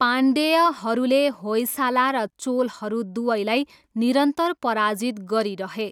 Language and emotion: Nepali, neutral